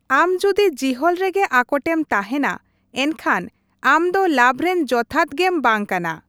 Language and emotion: Santali, neutral